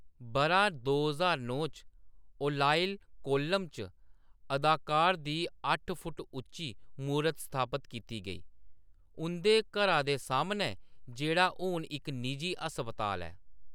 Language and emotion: Dogri, neutral